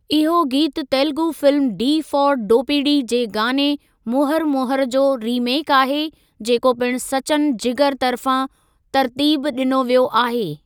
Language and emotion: Sindhi, neutral